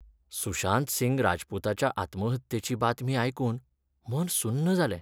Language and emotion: Goan Konkani, sad